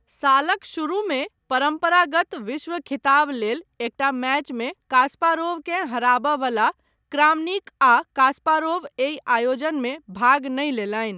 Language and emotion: Maithili, neutral